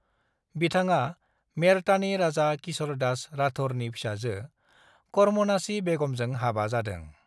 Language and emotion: Bodo, neutral